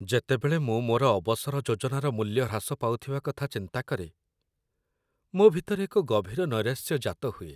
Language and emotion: Odia, sad